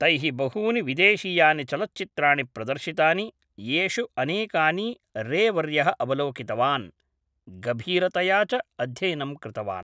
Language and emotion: Sanskrit, neutral